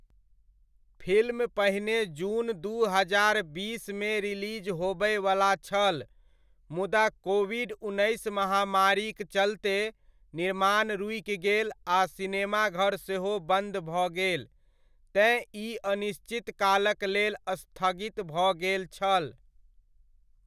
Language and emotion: Maithili, neutral